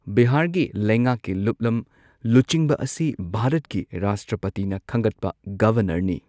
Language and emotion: Manipuri, neutral